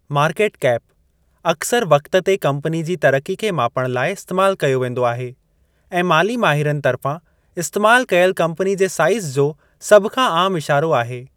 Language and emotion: Sindhi, neutral